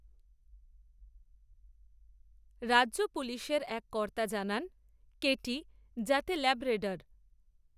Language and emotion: Bengali, neutral